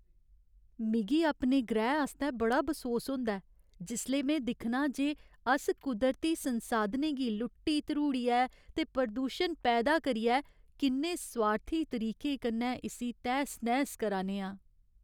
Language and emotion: Dogri, sad